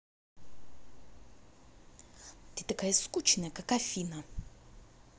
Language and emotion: Russian, angry